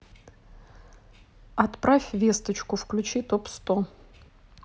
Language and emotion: Russian, neutral